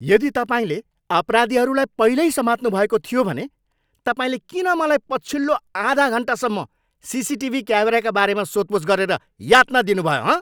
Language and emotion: Nepali, angry